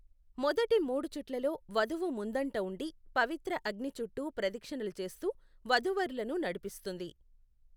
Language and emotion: Telugu, neutral